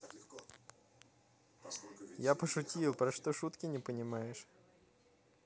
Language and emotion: Russian, positive